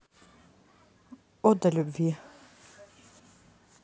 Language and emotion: Russian, neutral